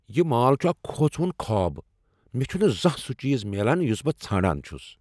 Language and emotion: Kashmiri, angry